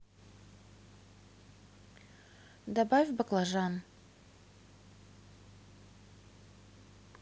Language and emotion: Russian, neutral